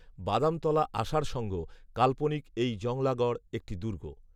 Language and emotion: Bengali, neutral